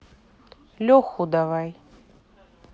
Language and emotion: Russian, neutral